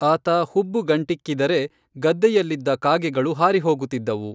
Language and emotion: Kannada, neutral